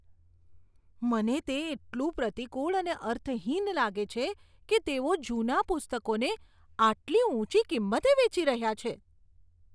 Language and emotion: Gujarati, disgusted